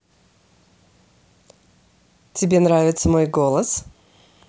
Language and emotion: Russian, positive